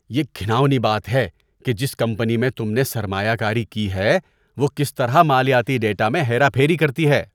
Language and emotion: Urdu, disgusted